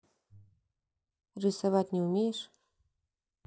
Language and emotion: Russian, neutral